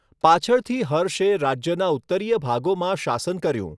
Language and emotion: Gujarati, neutral